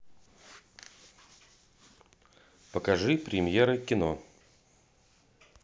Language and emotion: Russian, neutral